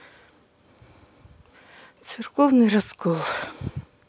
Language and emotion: Russian, sad